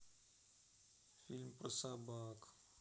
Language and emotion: Russian, sad